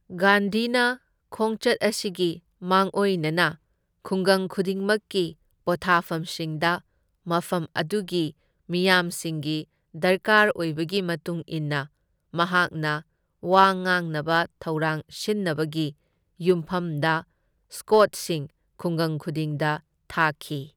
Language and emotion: Manipuri, neutral